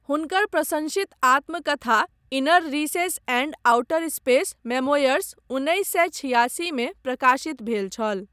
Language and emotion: Maithili, neutral